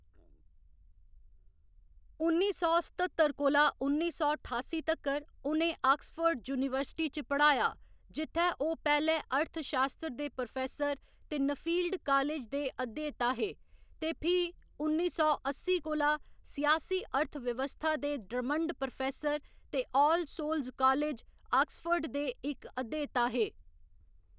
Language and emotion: Dogri, neutral